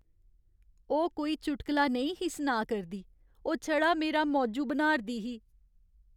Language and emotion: Dogri, sad